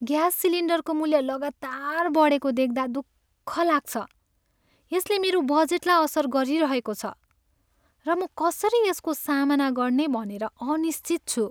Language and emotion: Nepali, sad